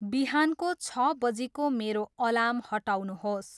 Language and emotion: Nepali, neutral